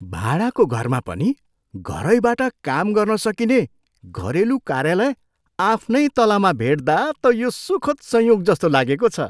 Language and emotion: Nepali, surprised